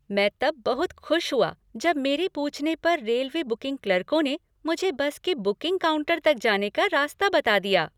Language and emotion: Hindi, happy